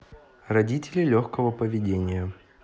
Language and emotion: Russian, neutral